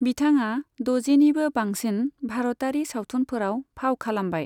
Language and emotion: Bodo, neutral